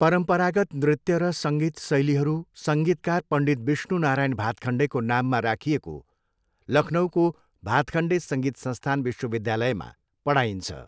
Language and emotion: Nepali, neutral